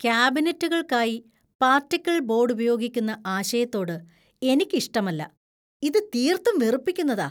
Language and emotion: Malayalam, disgusted